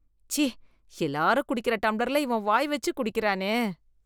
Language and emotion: Tamil, disgusted